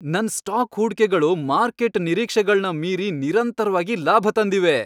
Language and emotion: Kannada, happy